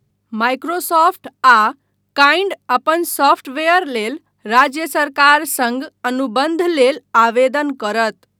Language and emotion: Maithili, neutral